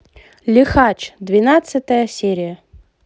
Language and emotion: Russian, positive